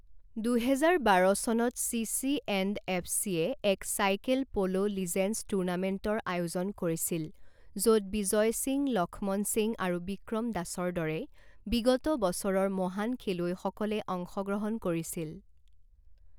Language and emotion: Assamese, neutral